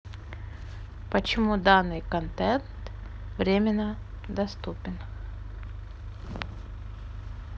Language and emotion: Russian, neutral